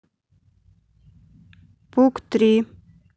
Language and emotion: Russian, neutral